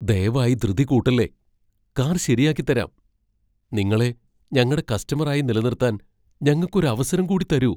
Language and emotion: Malayalam, fearful